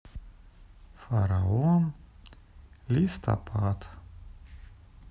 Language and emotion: Russian, sad